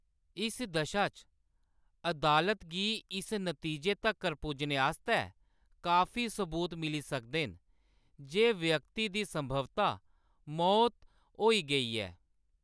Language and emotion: Dogri, neutral